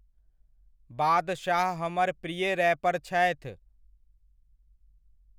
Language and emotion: Maithili, neutral